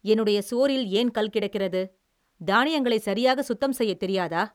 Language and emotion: Tamil, angry